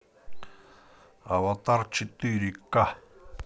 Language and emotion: Russian, neutral